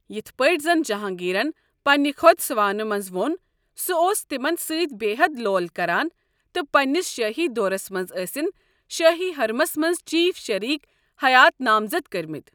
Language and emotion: Kashmiri, neutral